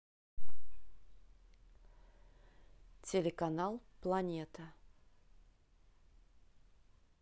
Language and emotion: Russian, neutral